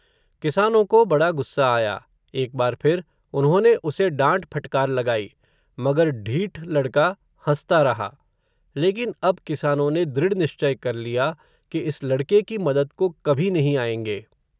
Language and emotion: Hindi, neutral